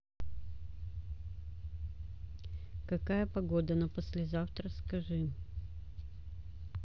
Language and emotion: Russian, neutral